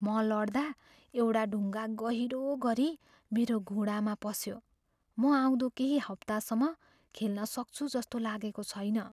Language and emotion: Nepali, fearful